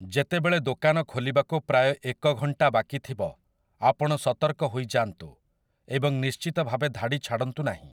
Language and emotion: Odia, neutral